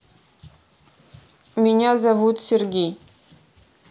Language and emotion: Russian, neutral